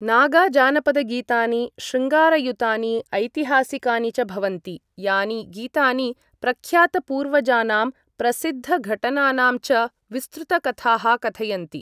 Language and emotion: Sanskrit, neutral